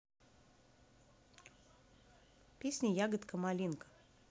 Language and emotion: Russian, neutral